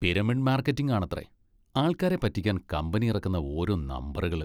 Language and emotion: Malayalam, disgusted